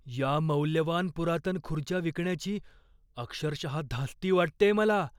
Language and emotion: Marathi, fearful